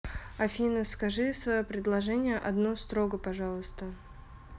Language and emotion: Russian, neutral